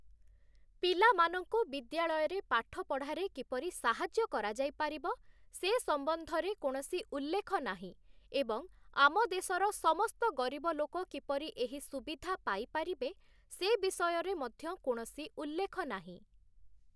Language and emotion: Odia, neutral